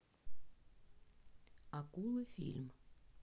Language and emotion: Russian, neutral